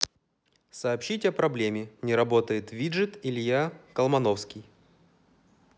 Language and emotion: Russian, neutral